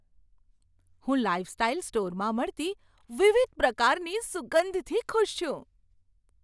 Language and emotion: Gujarati, surprised